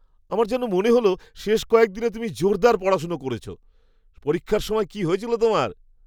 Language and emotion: Bengali, surprised